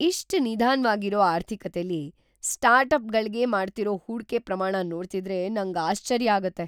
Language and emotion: Kannada, surprised